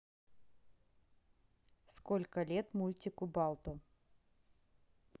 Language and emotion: Russian, neutral